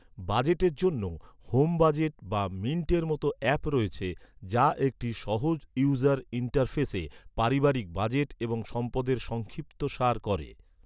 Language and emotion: Bengali, neutral